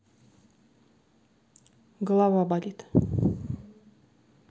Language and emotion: Russian, neutral